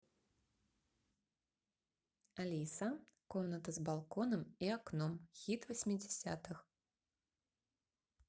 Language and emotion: Russian, neutral